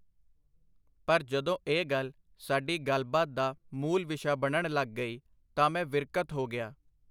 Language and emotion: Punjabi, neutral